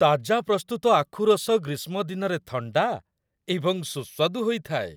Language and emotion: Odia, happy